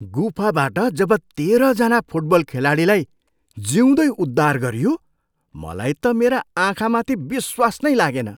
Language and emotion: Nepali, surprised